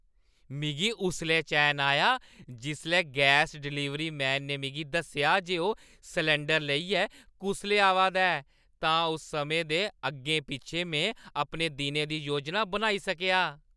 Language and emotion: Dogri, happy